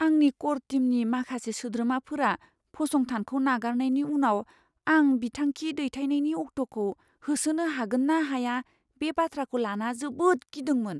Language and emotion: Bodo, fearful